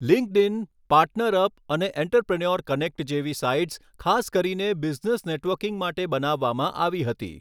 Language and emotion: Gujarati, neutral